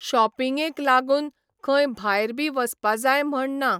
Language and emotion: Goan Konkani, neutral